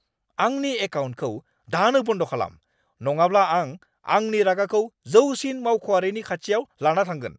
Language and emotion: Bodo, angry